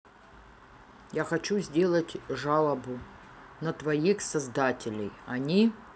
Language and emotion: Russian, neutral